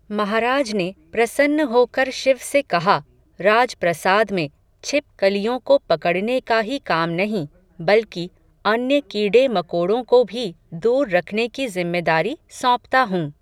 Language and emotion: Hindi, neutral